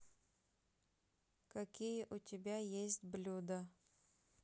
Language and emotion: Russian, neutral